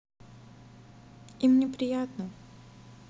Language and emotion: Russian, sad